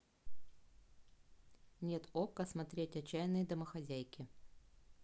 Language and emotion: Russian, neutral